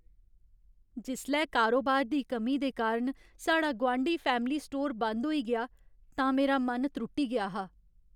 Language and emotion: Dogri, sad